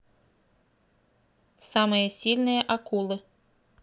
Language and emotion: Russian, neutral